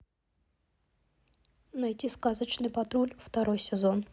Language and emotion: Russian, neutral